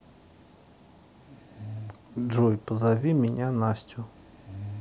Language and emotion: Russian, neutral